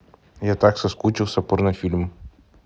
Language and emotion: Russian, neutral